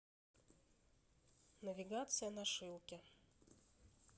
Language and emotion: Russian, neutral